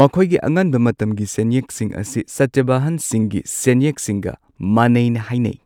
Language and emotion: Manipuri, neutral